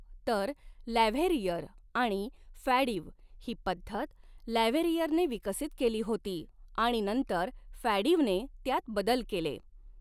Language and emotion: Marathi, neutral